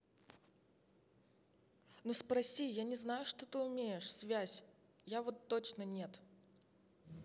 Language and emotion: Russian, angry